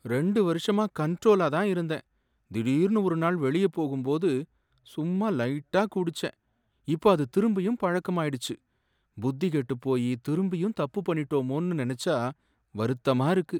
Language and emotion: Tamil, sad